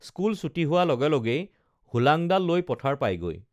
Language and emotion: Assamese, neutral